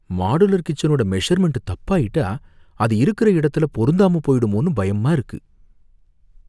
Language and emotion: Tamil, fearful